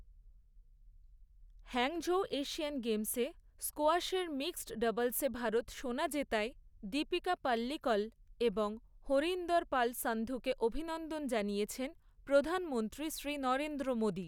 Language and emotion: Bengali, neutral